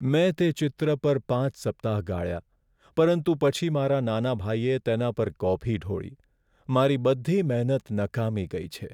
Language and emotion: Gujarati, sad